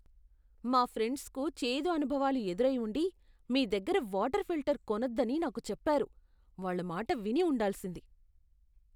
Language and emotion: Telugu, disgusted